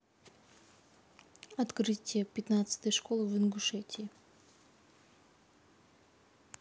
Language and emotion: Russian, neutral